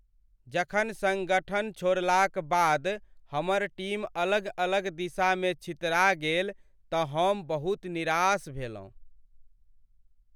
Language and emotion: Maithili, sad